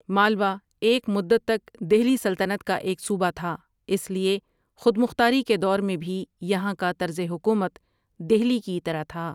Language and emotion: Urdu, neutral